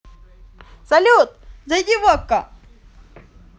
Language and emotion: Russian, positive